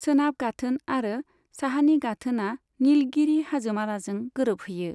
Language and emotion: Bodo, neutral